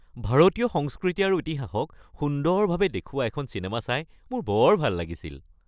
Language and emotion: Assamese, happy